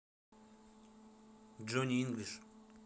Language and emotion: Russian, neutral